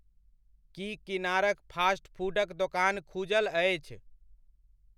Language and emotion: Maithili, neutral